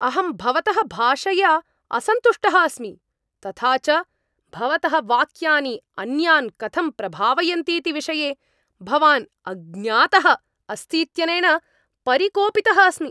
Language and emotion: Sanskrit, angry